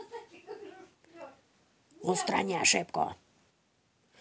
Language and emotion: Russian, angry